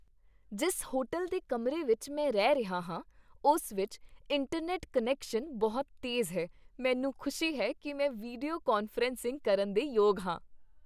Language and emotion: Punjabi, happy